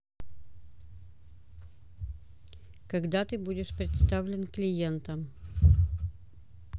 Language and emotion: Russian, neutral